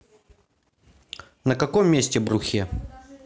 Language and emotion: Russian, neutral